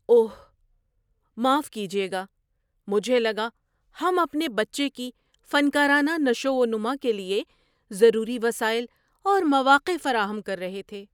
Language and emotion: Urdu, surprised